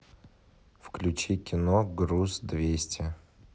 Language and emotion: Russian, neutral